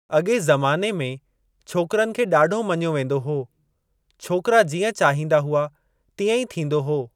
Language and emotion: Sindhi, neutral